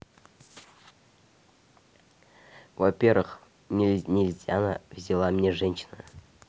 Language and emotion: Russian, neutral